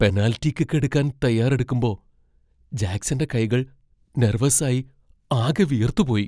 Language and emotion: Malayalam, fearful